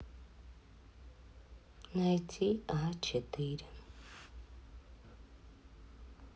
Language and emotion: Russian, sad